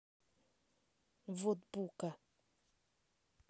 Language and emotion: Russian, neutral